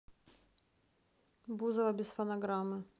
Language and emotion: Russian, neutral